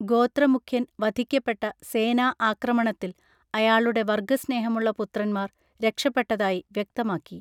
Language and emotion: Malayalam, neutral